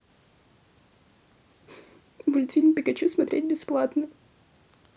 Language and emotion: Russian, sad